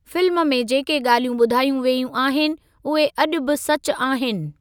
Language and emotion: Sindhi, neutral